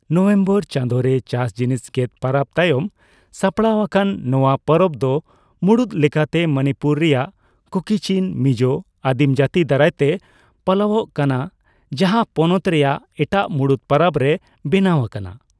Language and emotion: Santali, neutral